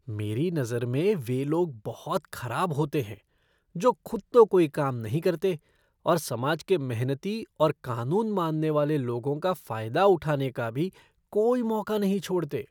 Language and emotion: Hindi, disgusted